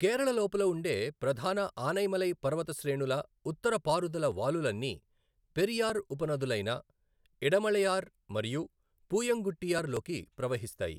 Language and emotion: Telugu, neutral